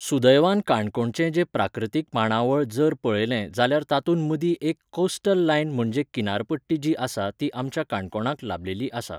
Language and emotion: Goan Konkani, neutral